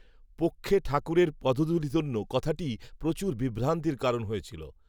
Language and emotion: Bengali, neutral